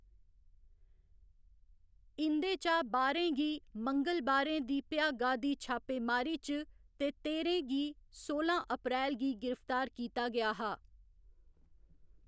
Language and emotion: Dogri, neutral